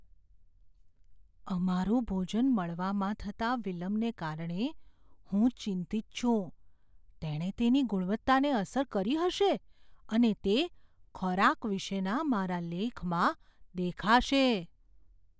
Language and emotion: Gujarati, fearful